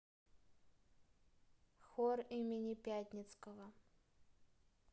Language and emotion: Russian, neutral